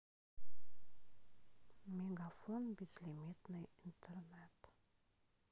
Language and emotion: Russian, sad